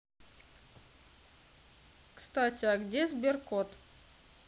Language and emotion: Russian, neutral